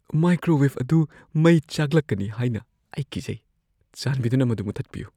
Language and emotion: Manipuri, fearful